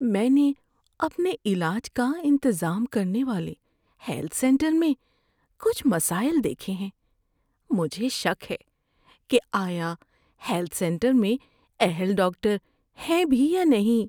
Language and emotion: Urdu, fearful